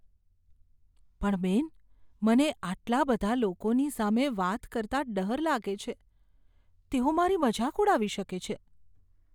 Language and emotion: Gujarati, fearful